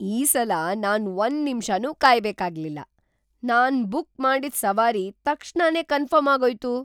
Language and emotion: Kannada, surprised